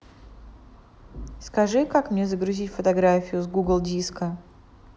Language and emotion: Russian, neutral